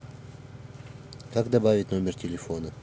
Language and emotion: Russian, neutral